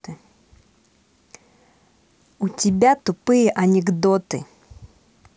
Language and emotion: Russian, angry